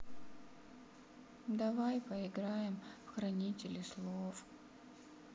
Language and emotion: Russian, sad